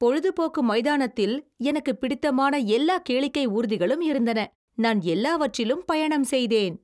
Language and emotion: Tamil, happy